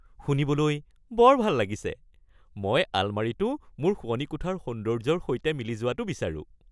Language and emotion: Assamese, happy